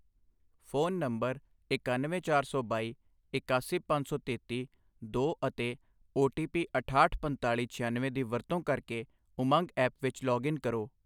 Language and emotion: Punjabi, neutral